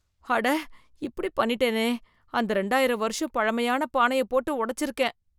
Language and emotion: Tamil, fearful